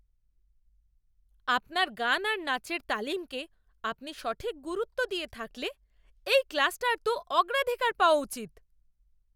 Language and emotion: Bengali, angry